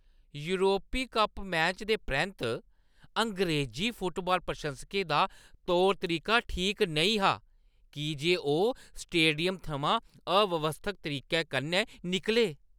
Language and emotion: Dogri, disgusted